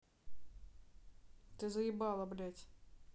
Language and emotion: Russian, angry